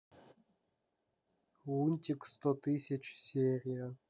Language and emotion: Russian, neutral